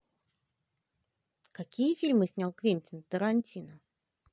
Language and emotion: Russian, positive